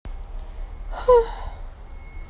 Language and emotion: Russian, sad